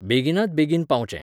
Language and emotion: Goan Konkani, neutral